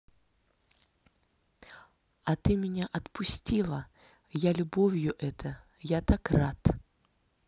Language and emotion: Russian, neutral